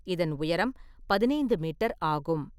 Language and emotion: Tamil, neutral